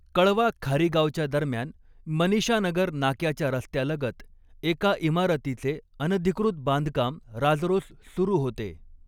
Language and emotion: Marathi, neutral